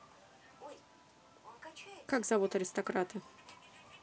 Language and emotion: Russian, neutral